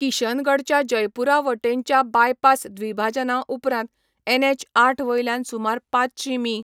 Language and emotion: Goan Konkani, neutral